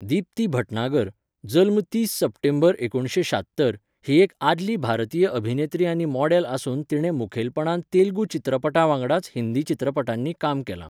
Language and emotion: Goan Konkani, neutral